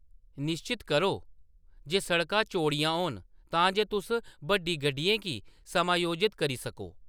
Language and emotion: Dogri, neutral